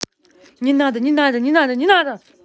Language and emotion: Russian, angry